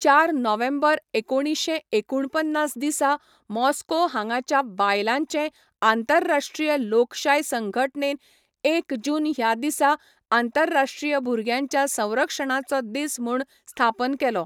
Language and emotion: Goan Konkani, neutral